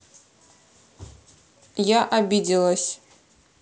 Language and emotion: Russian, angry